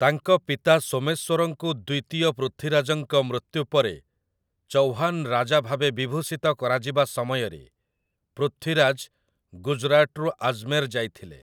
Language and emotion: Odia, neutral